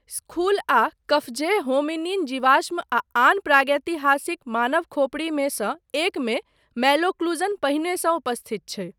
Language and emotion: Maithili, neutral